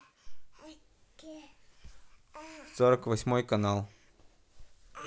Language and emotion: Russian, neutral